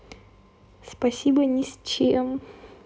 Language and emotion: Russian, neutral